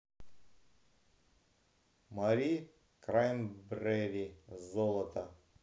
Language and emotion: Russian, neutral